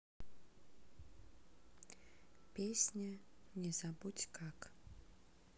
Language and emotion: Russian, sad